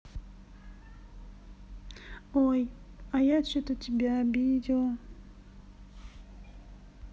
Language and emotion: Russian, sad